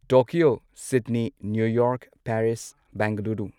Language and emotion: Manipuri, neutral